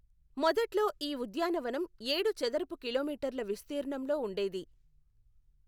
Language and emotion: Telugu, neutral